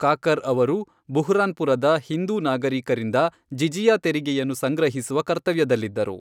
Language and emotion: Kannada, neutral